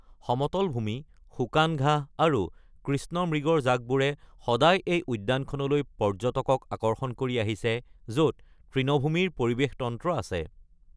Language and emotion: Assamese, neutral